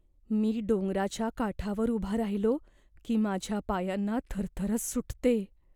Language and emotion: Marathi, fearful